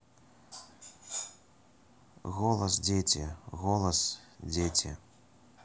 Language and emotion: Russian, neutral